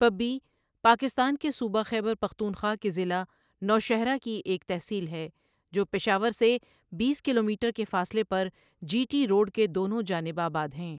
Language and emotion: Urdu, neutral